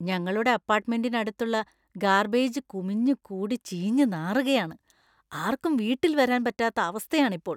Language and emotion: Malayalam, disgusted